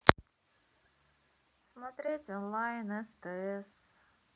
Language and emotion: Russian, sad